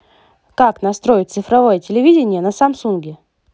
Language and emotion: Russian, positive